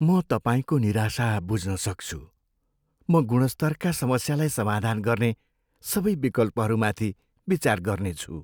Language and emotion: Nepali, sad